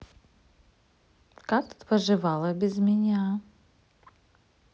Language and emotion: Russian, neutral